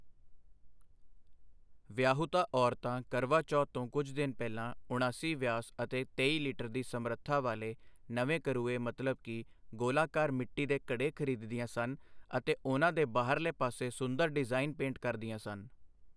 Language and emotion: Punjabi, neutral